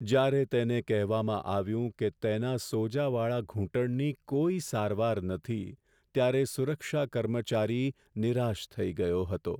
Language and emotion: Gujarati, sad